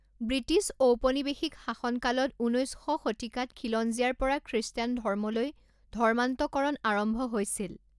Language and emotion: Assamese, neutral